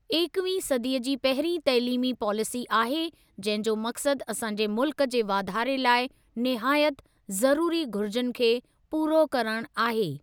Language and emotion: Sindhi, neutral